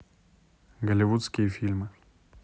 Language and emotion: Russian, neutral